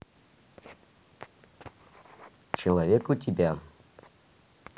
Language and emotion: Russian, neutral